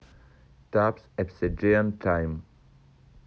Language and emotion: Russian, neutral